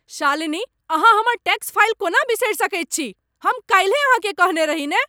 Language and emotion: Maithili, angry